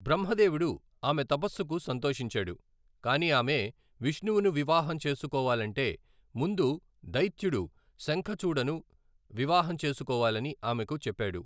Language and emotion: Telugu, neutral